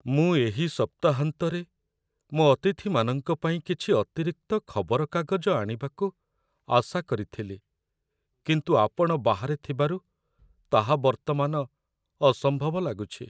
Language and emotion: Odia, sad